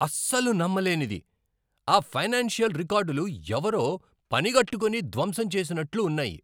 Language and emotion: Telugu, angry